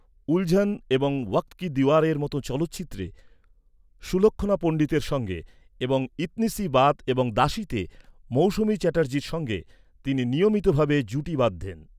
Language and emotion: Bengali, neutral